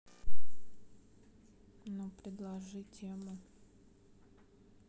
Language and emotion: Russian, sad